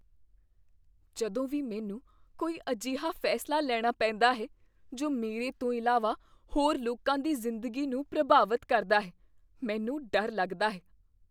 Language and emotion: Punjabi, fearful